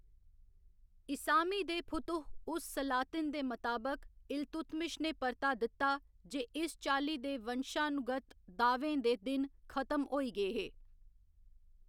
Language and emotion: Dogri, neutral